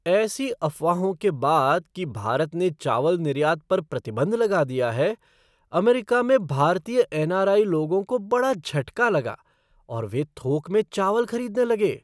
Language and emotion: Hindi, surprised